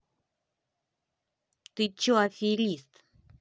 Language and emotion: Russian, angry